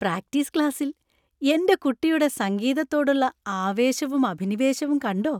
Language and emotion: Malayalam, happy